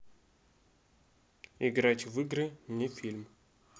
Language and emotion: Russian, neutral